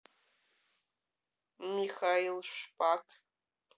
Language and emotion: Russian, neutral